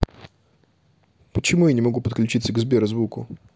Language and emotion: Russian, neutral